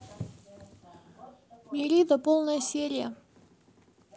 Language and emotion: Russian, neutral